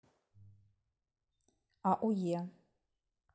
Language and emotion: Russian, neutral